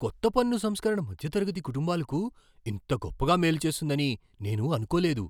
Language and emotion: Telugu, surprised